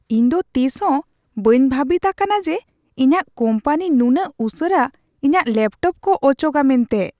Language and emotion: Santali, surprised